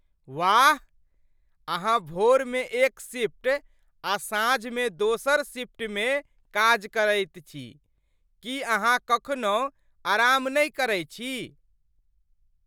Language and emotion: Maithili, surprised